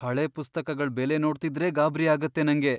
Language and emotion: Kannada, fearful